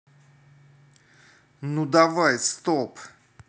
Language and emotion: Russian, angry